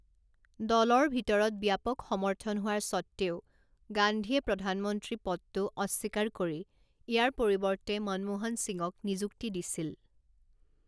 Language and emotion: Assamese, neutral